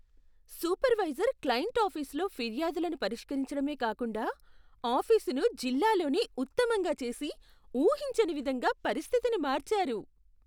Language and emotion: Telugu, surprised